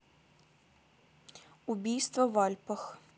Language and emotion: Russian, neutral